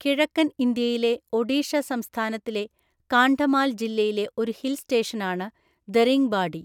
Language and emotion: Malayalam, neutral